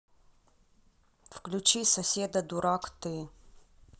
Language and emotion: Russian, neutral